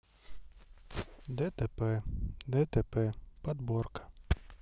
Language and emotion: Russian, neutral